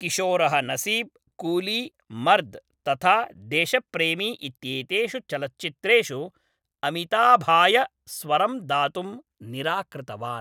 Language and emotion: Sanskrit, neutral